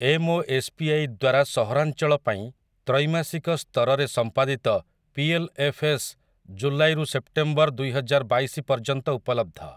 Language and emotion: Odia, neutral